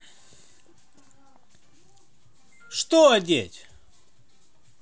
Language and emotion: Russian, angry